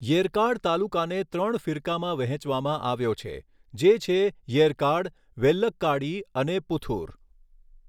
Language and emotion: Gujarati, neutral